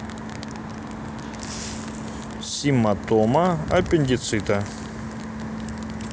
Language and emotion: Russian, neutral